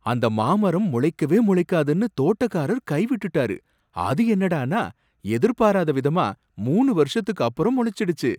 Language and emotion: Tamil, surprised